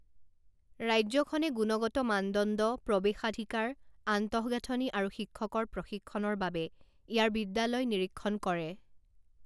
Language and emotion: Assamese, neutral